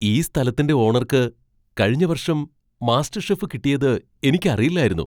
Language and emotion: Malayalam, surprised